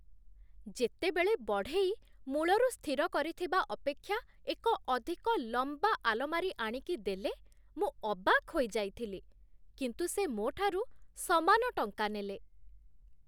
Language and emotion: Odia, surprised